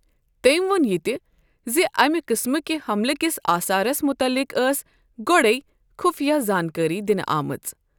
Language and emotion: Kashmiri, neutral